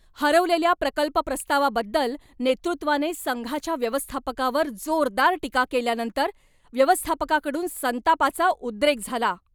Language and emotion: Marathi, angry